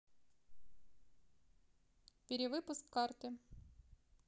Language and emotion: Russian, neutral